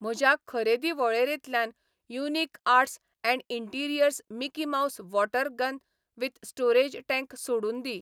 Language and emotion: Goan Konkani, neutral